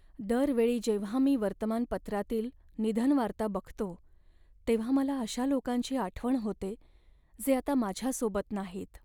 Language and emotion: Marathi, sad